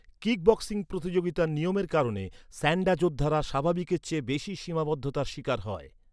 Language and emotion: Bengali, neutral